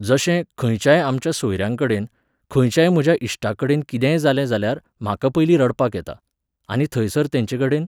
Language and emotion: Goan Konkani, neutral